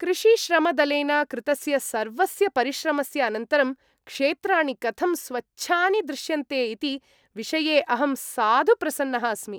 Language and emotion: Sanskrit, happy